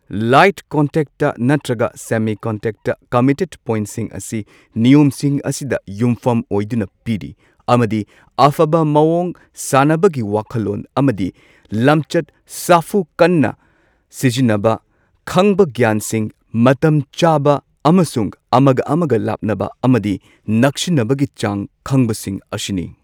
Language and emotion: Manipuri, neutral